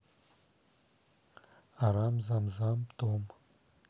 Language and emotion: Russian, neutral